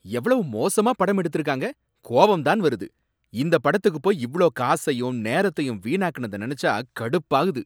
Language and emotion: Tamil, angry